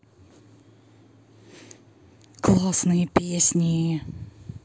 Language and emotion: Russian, positive